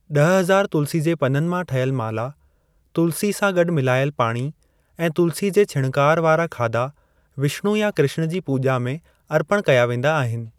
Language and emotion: Sindhi, neutral